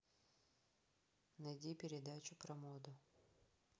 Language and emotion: Russian, neutral